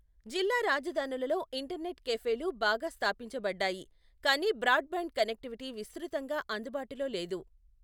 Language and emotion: Telugu, neutral